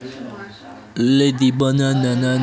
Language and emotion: Russian, neutral